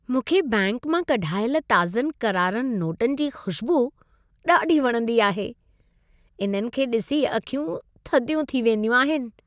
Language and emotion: Sindhi, happy